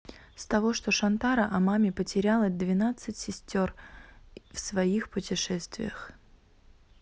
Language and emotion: Russian, neutral